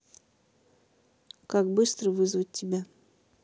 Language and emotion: Russian, neutral